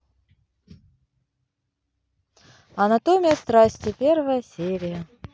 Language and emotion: Russian, positive